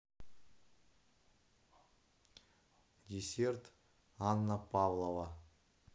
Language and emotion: Russian, neutral